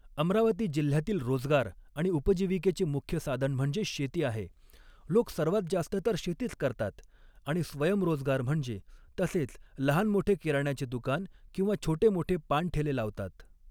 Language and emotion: Marathi, neutral